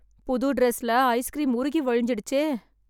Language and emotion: Tamil, sad